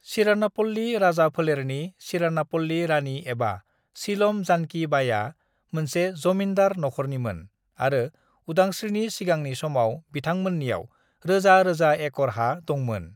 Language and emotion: Bodo, neutral